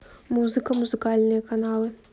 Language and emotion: Russian, neutral